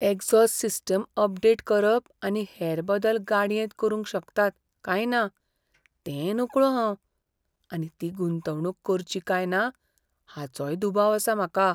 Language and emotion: Goan Konkani, fearful